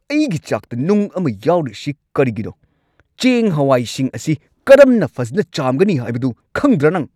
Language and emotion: Manipuri, angry